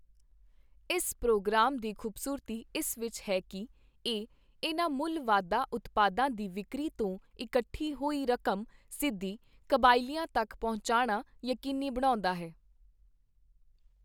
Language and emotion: Punjabi, neutral